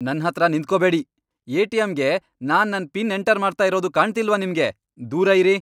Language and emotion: Kannada, angry